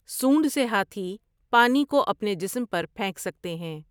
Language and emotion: Urdu, neutral